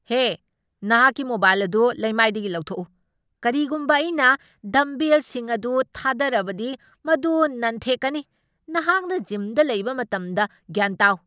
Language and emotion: Manipuri, angry